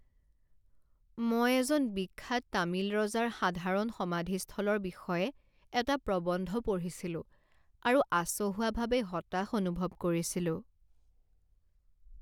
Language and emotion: Assamese, sad